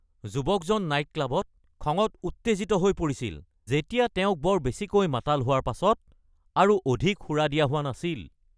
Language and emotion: Assamese, angry